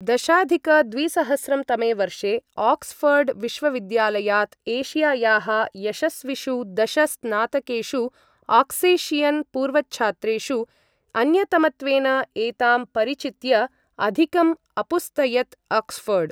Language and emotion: Sanskrit, neutral